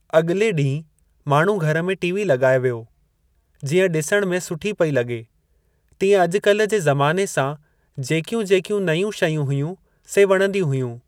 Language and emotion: Sindhi, neutral